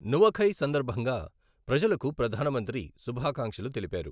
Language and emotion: Telugu, neutral